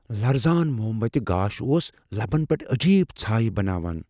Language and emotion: Kashmiri, fearful